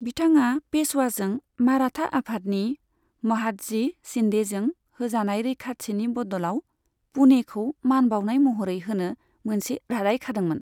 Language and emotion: Bodo, neutral